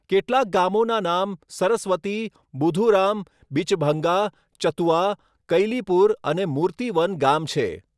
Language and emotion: Gujarati, neutral